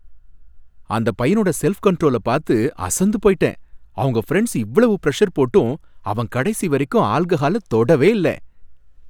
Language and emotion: Tamil, happy